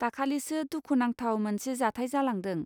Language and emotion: Bodo, neutral